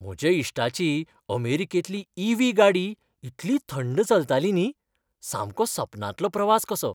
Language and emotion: Goan Konkani, happy